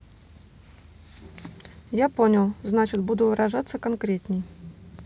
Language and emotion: Russian, neutral